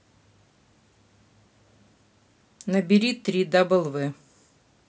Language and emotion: Russian, neutral